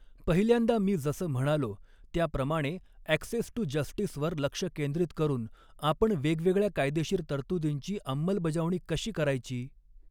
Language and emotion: Marathi, neutral